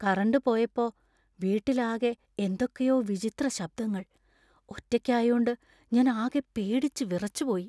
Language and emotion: Malayalam, fearful